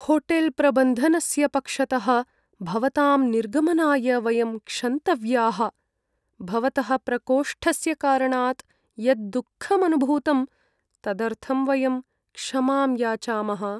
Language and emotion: Sanskrit, sad